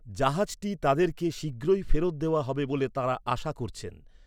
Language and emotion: Bengali, neutral